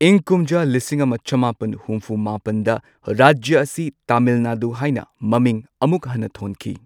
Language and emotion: Manipuri, neutral